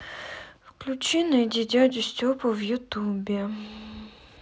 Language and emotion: Russian, sad